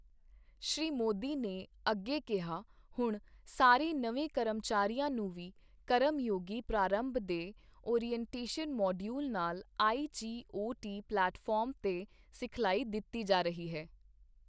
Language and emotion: Punjabi, neutral